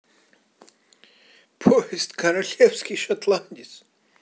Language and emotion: Russian, positive